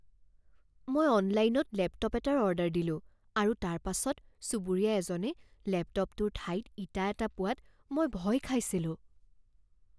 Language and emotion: Assamese, fearful